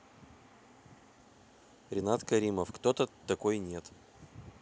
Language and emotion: Russian, neutral